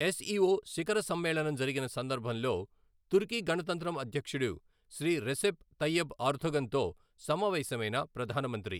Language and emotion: Telugu, neutral